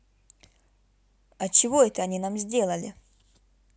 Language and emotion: Russian, neutral